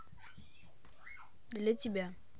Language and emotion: Russian, neutral